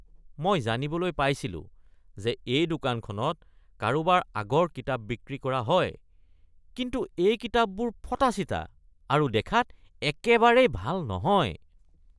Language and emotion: Assamese, disgusted